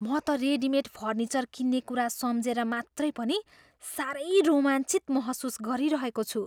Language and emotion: Nepali, surprised